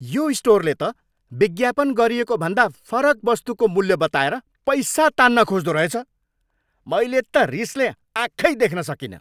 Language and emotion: Nepali, angry